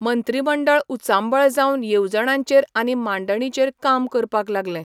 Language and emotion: Goan Konkani, neutral